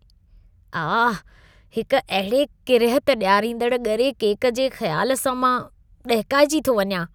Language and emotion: Sindhi, disgusted